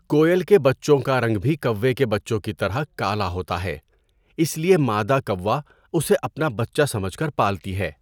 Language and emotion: Urdu, neutral